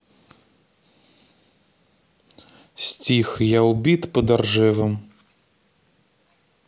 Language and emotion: Russian, neutral